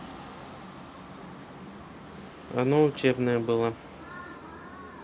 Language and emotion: Russian, neutral